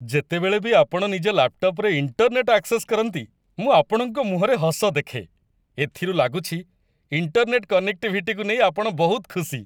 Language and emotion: Odia, happy